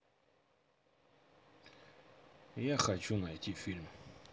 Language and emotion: Russian, neutral